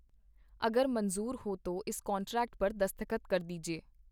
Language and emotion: Punjabi, neutral